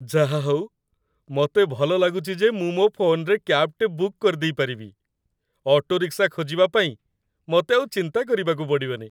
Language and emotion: Odia, happy